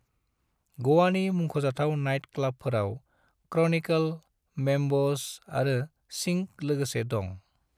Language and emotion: Bodo, neutral